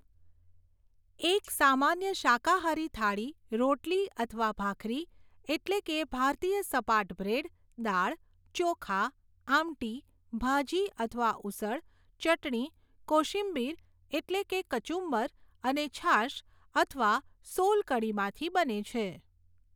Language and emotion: Gujarati, neutral